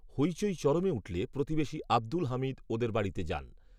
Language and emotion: Bengali, neutral